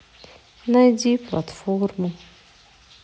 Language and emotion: Russian, sad